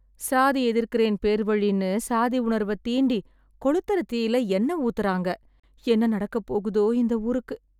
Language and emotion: Tamil, sad